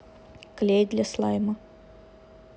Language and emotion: Russian, neutral